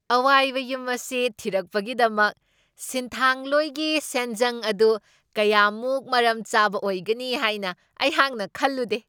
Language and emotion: Manipuri, surprised